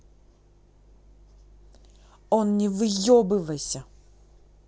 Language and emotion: Russian, angry